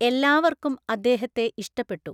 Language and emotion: Malayalam, neutral